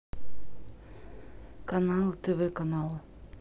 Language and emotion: Russian, neutral